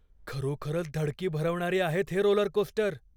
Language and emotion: Marathi, fearful